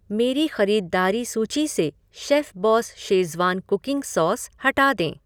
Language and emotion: Hindi, neutral